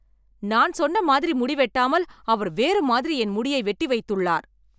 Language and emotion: Tamil, angry